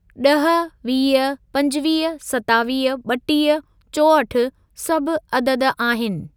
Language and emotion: Sindhi, neutral